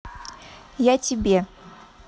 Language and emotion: Russian, neutral